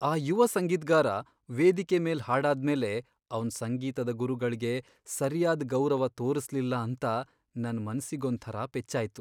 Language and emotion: Kannada, sad